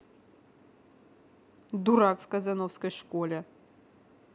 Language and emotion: Russian, angry